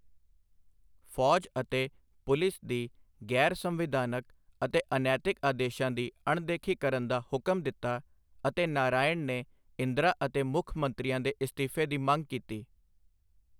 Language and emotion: Punjabi, neutral